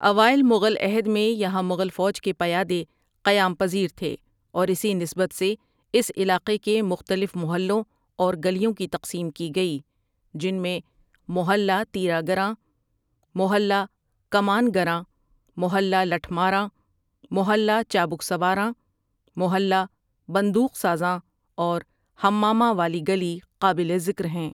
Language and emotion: Urdu, neutral